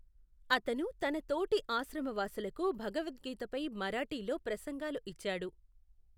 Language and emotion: Telugu, neutral